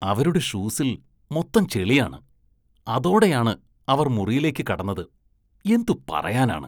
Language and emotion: Malayalam, disgusted